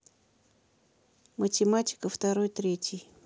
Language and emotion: Russian, neutral